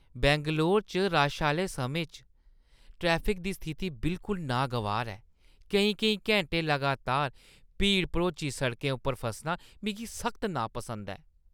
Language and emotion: Dogri, disgusted